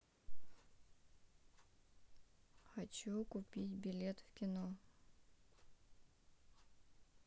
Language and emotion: Russian, neutral